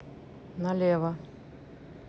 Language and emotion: Russian, neutral